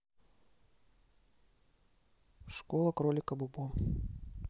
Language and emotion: Russian, neutral